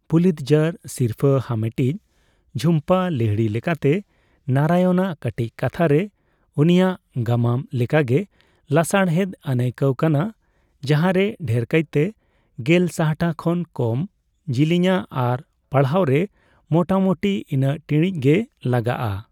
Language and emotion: Santali, neutral